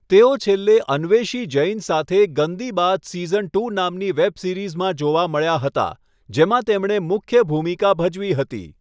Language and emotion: Gujarati, neutral